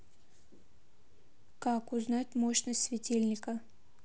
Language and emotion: Russian, neutral